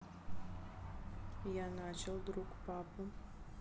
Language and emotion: Russian, neutral